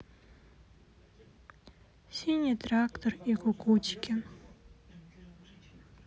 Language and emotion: Russian, sad